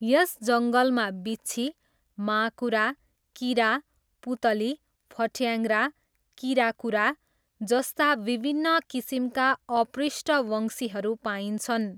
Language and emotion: Nepali, neutral